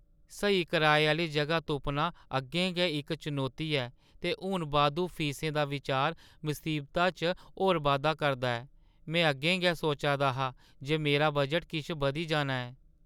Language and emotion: Dogri, sad